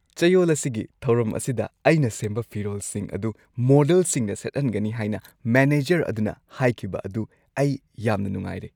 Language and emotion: Manipuri, happy